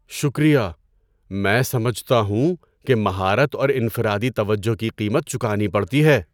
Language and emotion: Urdu, surprised